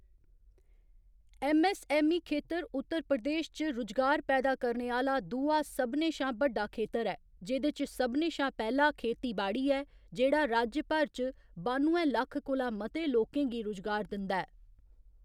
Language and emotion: Dogri, neutral